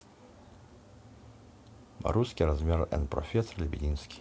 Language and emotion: Russian, neutral